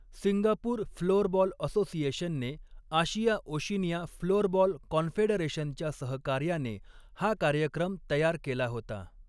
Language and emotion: Marathi, neutral